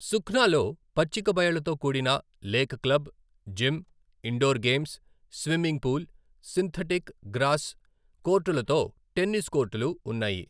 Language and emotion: Telugu, neutral